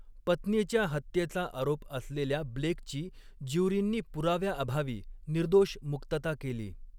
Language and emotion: Marathi, neutral